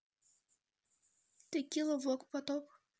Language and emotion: Russian, neutral